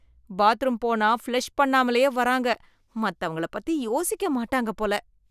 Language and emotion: Tamil, disgusted